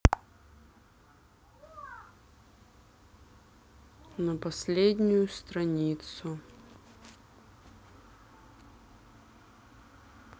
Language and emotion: Russian, sad